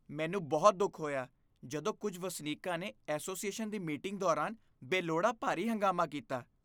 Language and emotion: Punjabi, disgusted